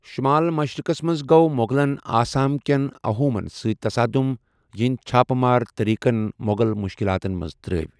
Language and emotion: Kashmiri, neutral